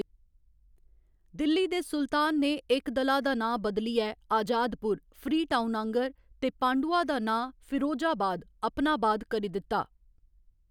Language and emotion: Dogri, neutral